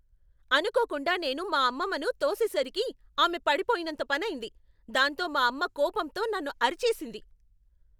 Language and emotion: Telugu, angry